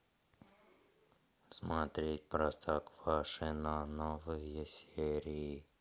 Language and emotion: Russian, neutral